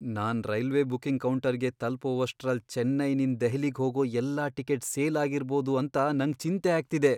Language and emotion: Kannada, fearful